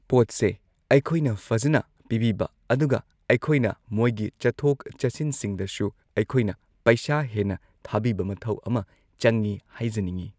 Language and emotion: Manipuri, neutral